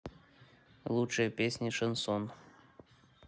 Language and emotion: Russian, neutral